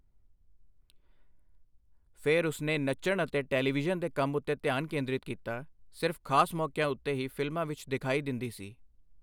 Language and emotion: Punjabi, neutral